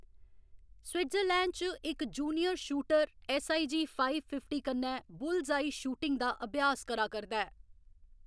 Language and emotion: Dogri, neutral